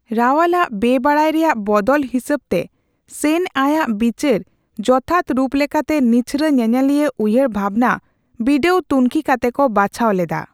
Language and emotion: Santali, neutral